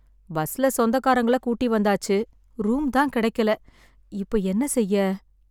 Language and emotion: Tamil, sad